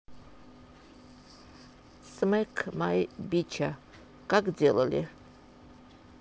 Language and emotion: Russian, neutral